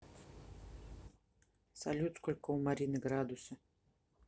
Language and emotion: Russian, neutral